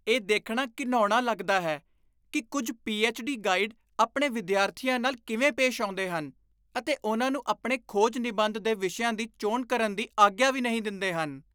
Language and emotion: Punjabi, disgusted